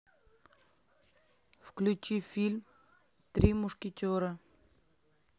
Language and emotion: Russian, neutral